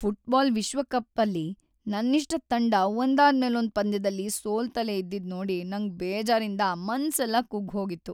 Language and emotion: Kannada, sad